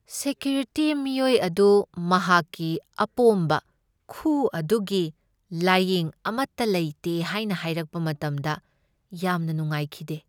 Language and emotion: Manipuri, sad